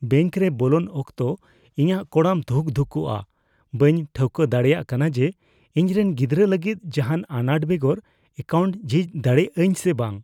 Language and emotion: Santali, fearful